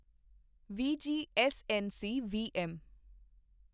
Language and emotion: Punjabi, neutral